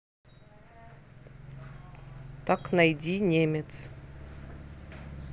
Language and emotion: Russian, neutral